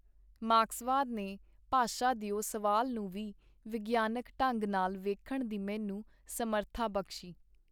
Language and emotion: Punjabi, neutral